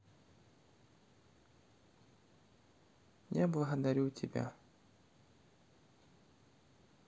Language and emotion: Russian, sad